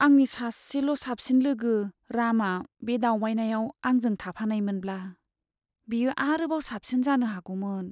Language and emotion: Bodo, sad